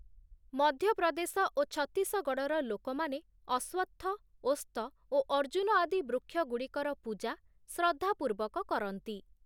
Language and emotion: Odia, neutral